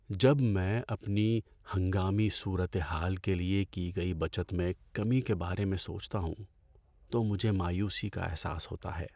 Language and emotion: Urdu, sad